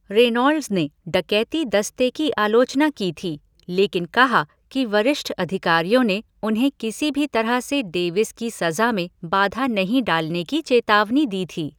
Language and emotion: Hindi, neutral